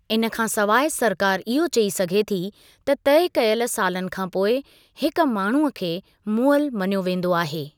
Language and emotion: Sindhi, neutral